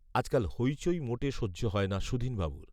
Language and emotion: Bengali, neutral